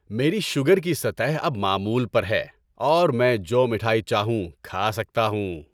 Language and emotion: Urdu, happy